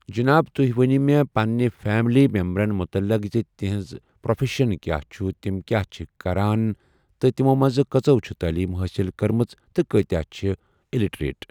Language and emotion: Kashmiri, neutral